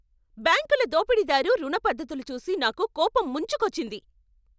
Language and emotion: Telugu, angry